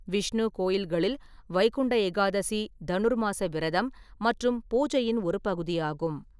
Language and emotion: Tamil, neutral